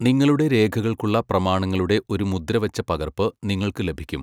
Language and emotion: Malayalam, neutral